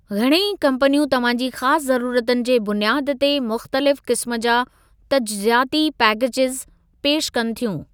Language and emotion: Sindhi, neutral